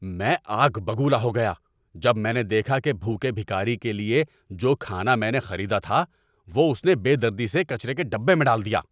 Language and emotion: Urdu, angry